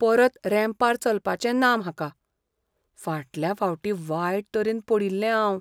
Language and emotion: Goan Konkani, fearful